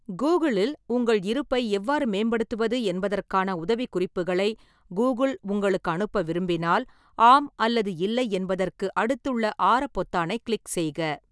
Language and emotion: Tamil, neutral